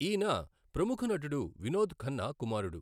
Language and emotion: Telugu, neutral